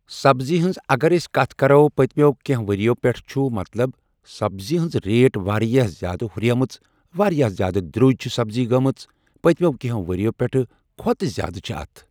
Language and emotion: Kashmiri, neutral